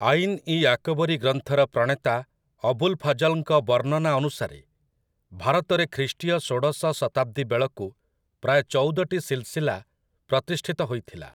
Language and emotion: Odia, neutral